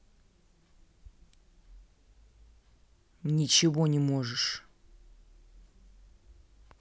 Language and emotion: Russian, angry